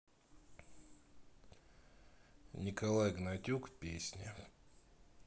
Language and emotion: Russian, sad